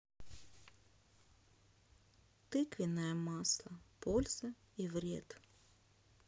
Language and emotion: Russian, sad